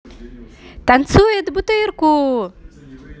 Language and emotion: Russian, positive